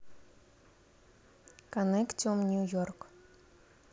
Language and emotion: Russian, neutral